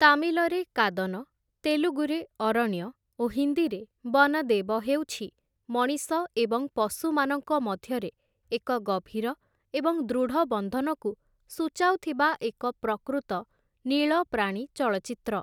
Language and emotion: Odia, neutral